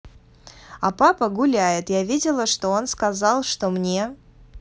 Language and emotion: Russian, neutral